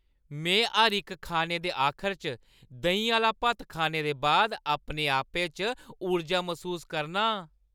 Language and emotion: Dogri, happy